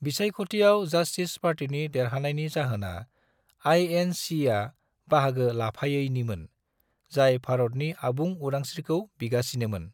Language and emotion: Bodo, neutral